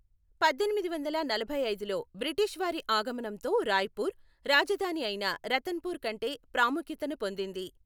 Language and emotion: Telugu, neutral